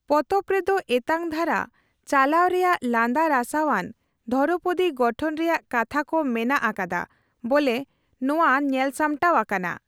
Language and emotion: Santali, neutral